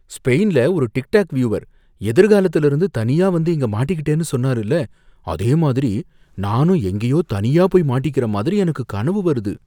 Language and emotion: Tamil, fearful